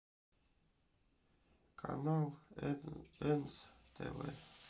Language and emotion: Russian, sad